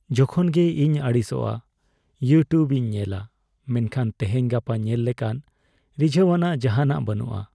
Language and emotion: Santali, sad